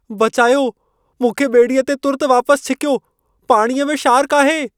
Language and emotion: Sindhi, fearful